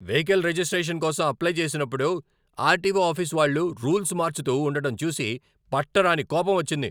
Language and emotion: Telugu, angry